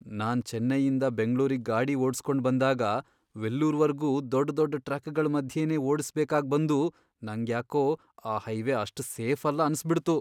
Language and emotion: Kannada, fearful